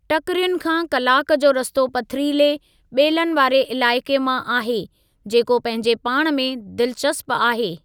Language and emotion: Sindhi, neutral